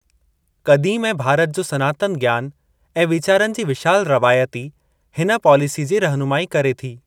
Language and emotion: Sindhi, neutral